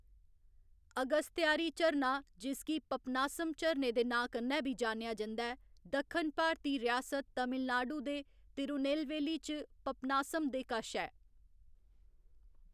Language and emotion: Dogri, neutral